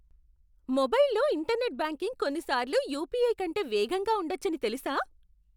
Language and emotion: Telugu, surprised